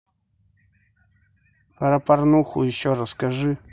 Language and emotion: Russian, neutral